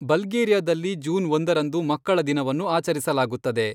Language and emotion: Kannada, neutral